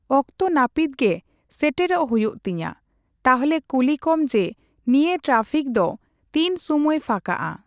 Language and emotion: Santali, neutral